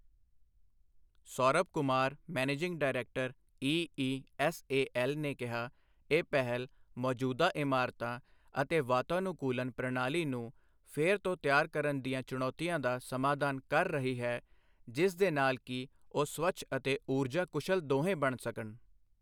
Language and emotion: Punjabi, neutral